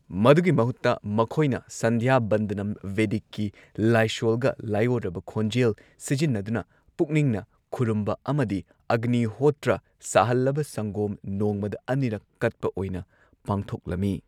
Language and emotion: Manipuri, neutral